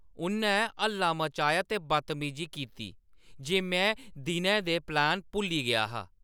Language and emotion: Dogri, angry